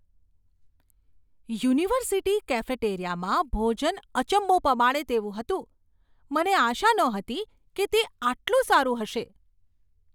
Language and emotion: Gujarati, surprised